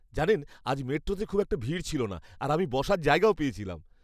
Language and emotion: Bengali, happy